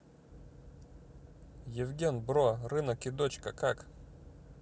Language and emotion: Russian, neutral